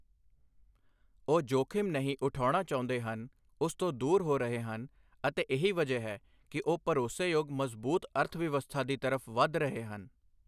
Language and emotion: Punjabi, neutral